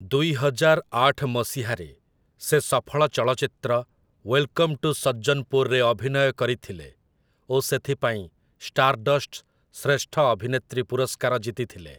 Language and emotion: Odia, neutral